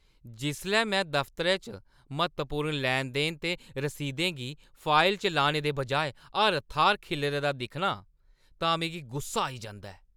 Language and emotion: Dogri, angry